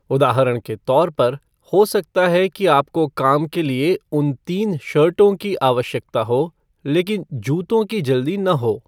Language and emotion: Hindi, neutral